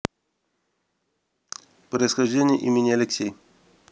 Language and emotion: Russian, neutral